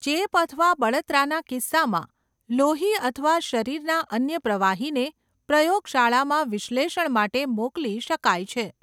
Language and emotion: Gujarati, neutral